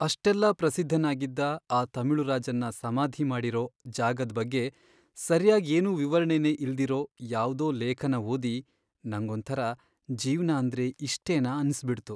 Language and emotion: Kannada, sad